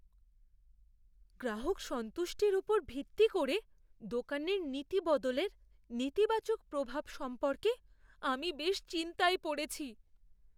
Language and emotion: Bengali, fearful